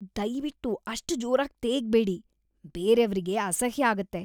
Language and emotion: Kannada, disgusted